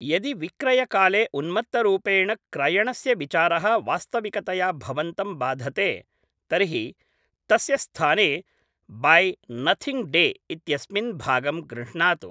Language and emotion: Sanskrit, neutral